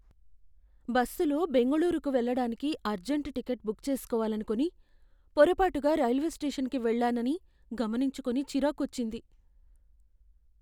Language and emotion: Telugu, fearful